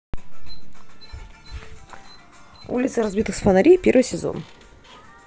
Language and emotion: Russian, neutral